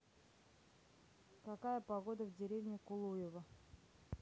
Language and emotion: Russian, neutral